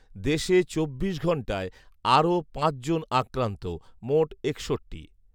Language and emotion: Bengali, neutral